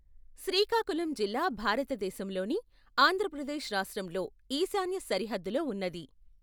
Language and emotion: Telugu, neutral